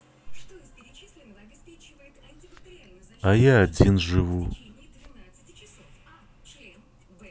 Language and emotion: Russian, sad